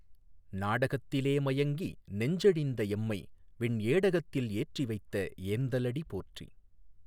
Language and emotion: Tamil, neutral